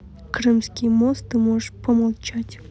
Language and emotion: Russian, neutral